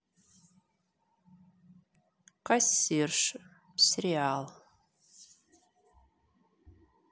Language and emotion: Russian, neutral